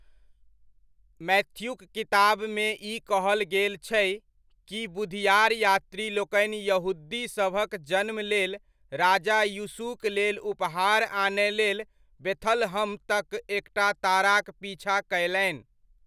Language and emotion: Maithili, neutral